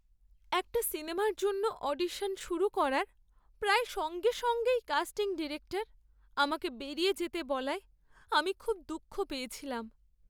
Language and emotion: Bengali, sad